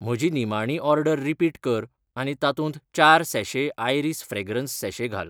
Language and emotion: Goan Konkani, neutral